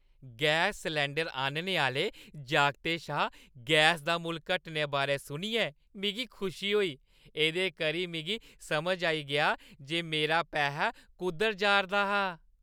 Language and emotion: Dogri, happy